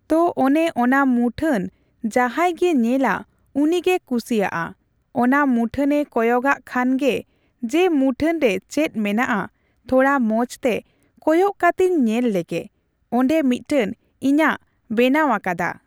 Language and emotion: Santali, neutral